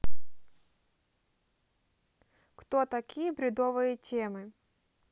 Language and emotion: Russian, neutral